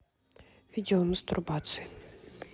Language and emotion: Russian, neutral